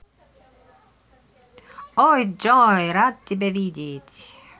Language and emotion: Russian, positive